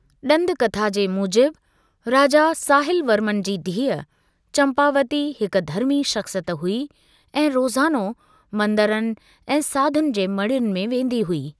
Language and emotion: Sindhi, neutral